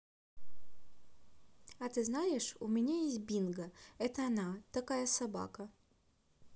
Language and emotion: Russian, neutral